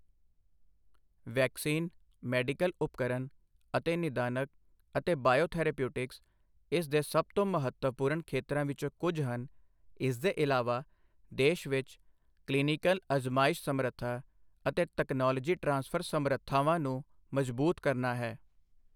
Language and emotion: Punjabi, neutral